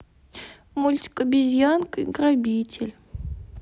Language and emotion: Russian, sad